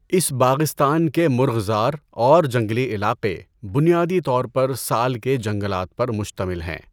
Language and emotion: Urdu, neutral